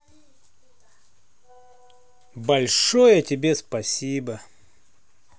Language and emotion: Russian, positive